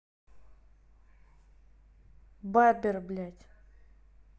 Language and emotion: Russian, angry